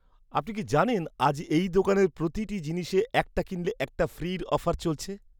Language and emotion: Bengali, surprised